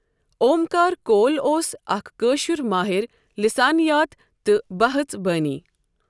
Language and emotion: Kashmiri, neutral